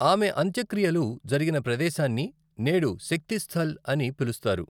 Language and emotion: Telugu, neutral